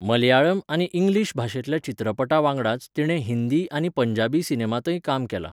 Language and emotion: Goan Konkani, neutral